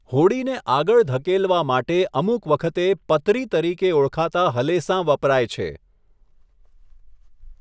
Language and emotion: Gujarati, neutral